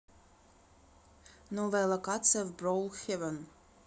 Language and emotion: Russian, neutral